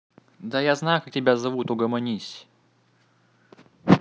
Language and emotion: Russian, neutral